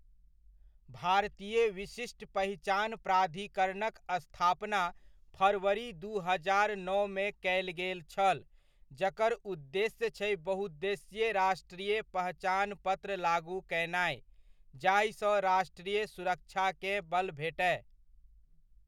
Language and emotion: Maithili, neutral